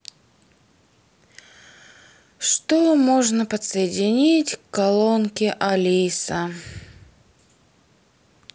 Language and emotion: Russian, neutral